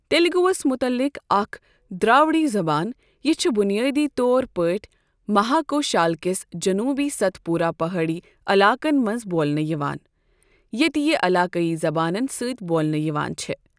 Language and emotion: Kashmiri, neutral